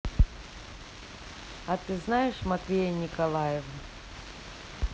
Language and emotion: Russian, neutral